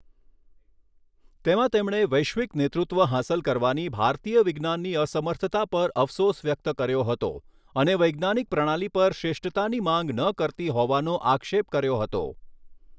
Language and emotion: Gujarati, neutral